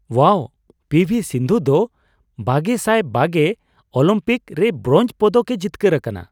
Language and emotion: Santali, surprised